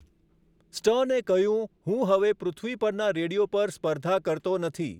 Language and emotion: Gujarati, neutral